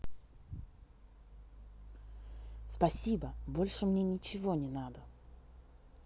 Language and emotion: Russian, angry